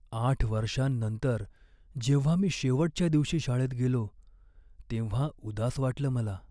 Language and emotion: Marathi, sad